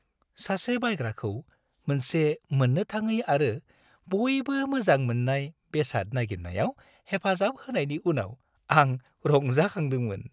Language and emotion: Bodo, happy